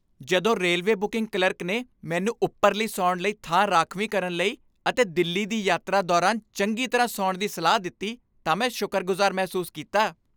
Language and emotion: Punjabi, happy